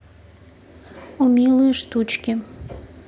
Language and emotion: Russian, neutral